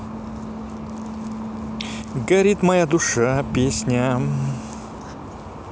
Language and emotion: Russian, positive